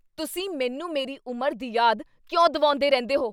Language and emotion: Punjabi, angry